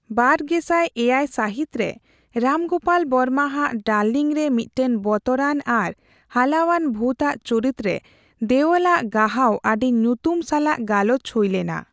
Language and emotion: Santali, neutral